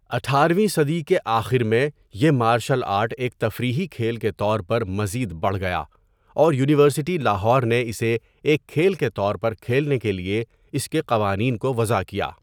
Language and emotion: Urdu, neutral